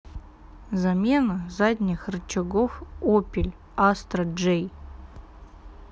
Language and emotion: Russian, neutral